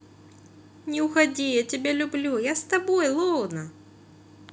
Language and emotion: Russian, positive